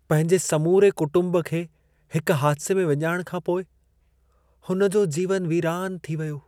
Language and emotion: Sindhi, sad